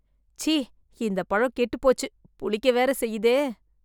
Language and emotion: Tamil, disgusted